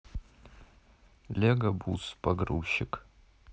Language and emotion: Russian, neutral